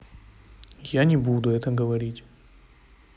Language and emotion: Russian, neutral